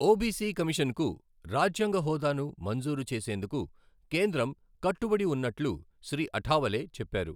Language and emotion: Telugu, neutral